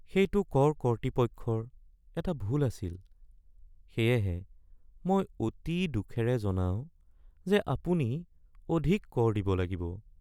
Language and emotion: Assamese, sad